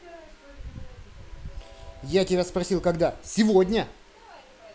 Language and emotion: Russian, angry